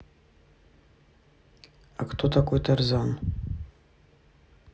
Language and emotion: Russian, neutral